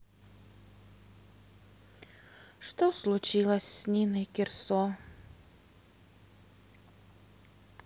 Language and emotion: Russian, sad